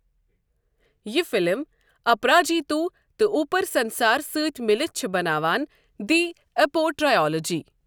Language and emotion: Kashmiri, neutral